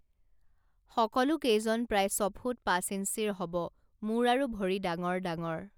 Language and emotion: Assamese, neutral